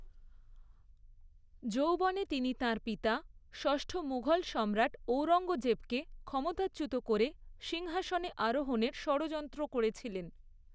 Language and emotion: Bengali, neutral